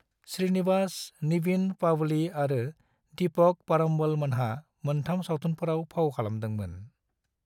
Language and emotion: Bodo, neutral